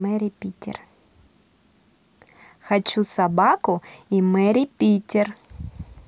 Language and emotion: Russian, positive